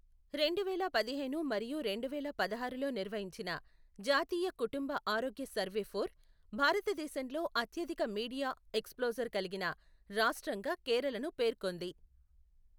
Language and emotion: Telugu, neutral